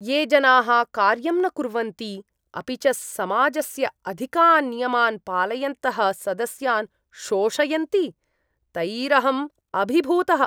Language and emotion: Sanskrit, disgusted